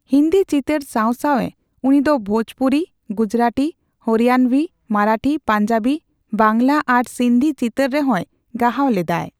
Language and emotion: Santali, neutral